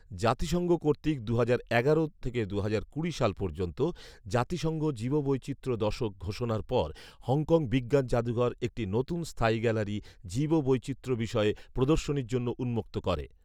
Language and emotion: Bengali, neutral